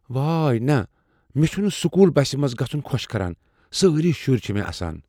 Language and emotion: Kashmiri, fearful